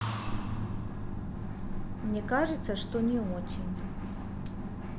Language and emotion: Russian, neutral